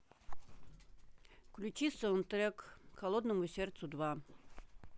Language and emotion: Russian, neutral